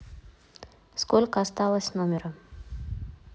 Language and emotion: Russian, neutral